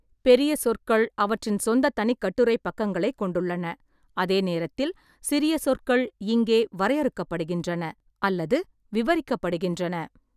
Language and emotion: Tamil, neutral